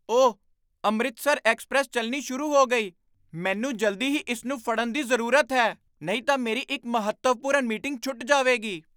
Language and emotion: Punjabi, surprised